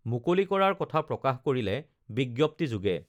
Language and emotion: Assamese, neutral